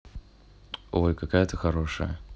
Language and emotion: Russian, positive